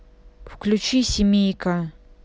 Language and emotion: Russian, neutral